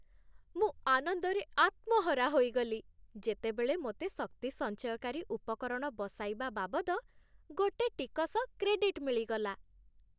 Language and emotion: Odia, happy